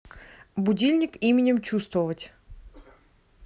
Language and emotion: Russian, neutral